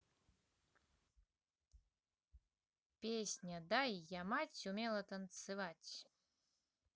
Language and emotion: Russian, positive